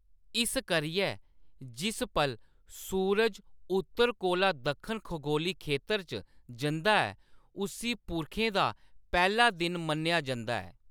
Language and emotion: Dogri, neutral